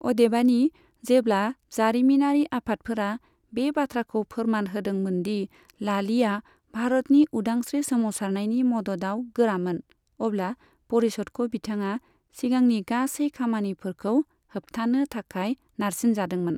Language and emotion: Bodo, neutral